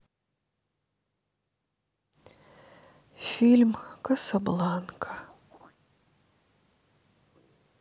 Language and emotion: Russian, sad